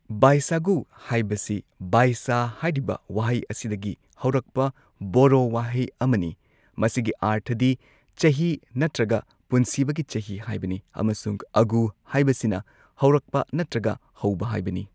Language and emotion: Manipuri, neutral